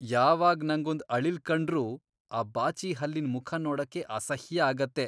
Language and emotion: Kannada, disgusted